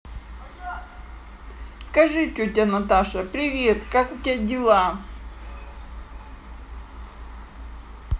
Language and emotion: Russian, neutral